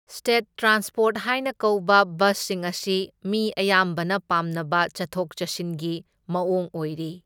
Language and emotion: Manipuri, neutral